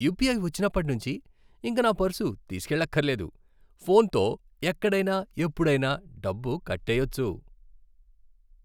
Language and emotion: Telugu, happy